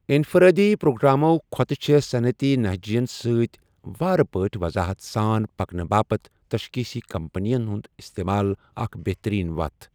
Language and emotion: Kashmiri, neutral